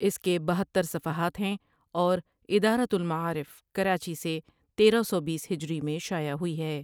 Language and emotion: Urdu, neutral